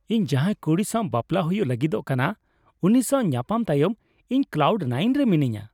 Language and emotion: Santali, happy